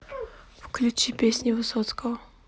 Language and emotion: Russian, neutral